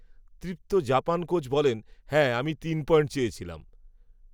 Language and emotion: Bengali, neutral